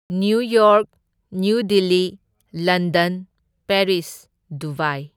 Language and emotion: Manipuri, neutral